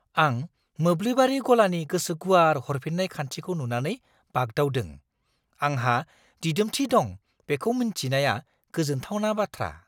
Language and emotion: Bodo, surprised